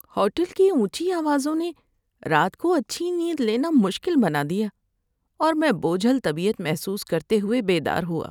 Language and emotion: Urdu, sad